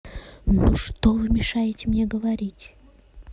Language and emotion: Russian, angry